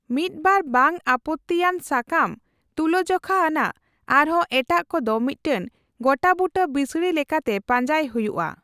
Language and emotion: Santali, neutral